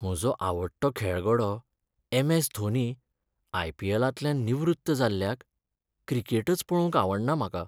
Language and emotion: Goan Konkani, sad